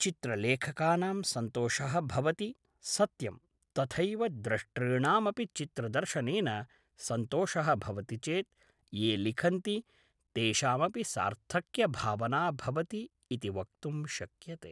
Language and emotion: Sanskrit, neutral